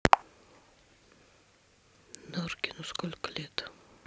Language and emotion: Russian, neutral